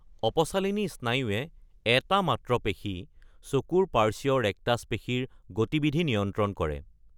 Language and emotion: Assamese, neutral